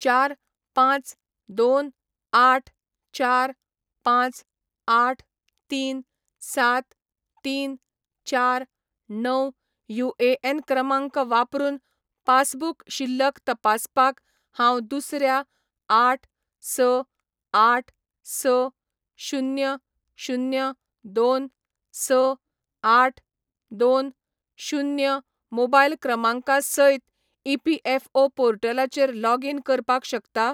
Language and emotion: Goan Konkani, neutral